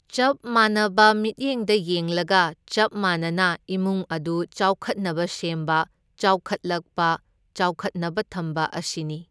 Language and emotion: Manipuri, neutral